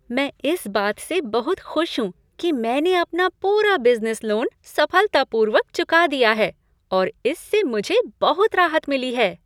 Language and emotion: Hindi, happy